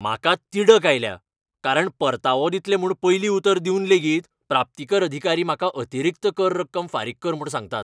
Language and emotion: Goan Konkani, angry